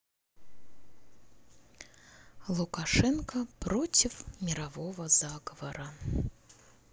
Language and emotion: Russian, neutral